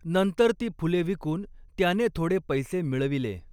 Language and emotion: Marathi, neutral